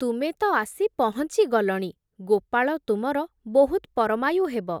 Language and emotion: Odia, neutral